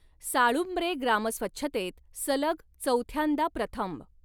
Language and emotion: Marathi, neutral